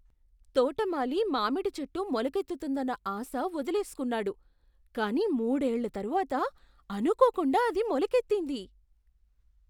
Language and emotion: Telugu, surprised